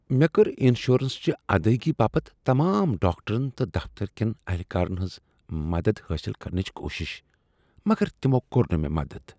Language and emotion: Kashmiri, disgusted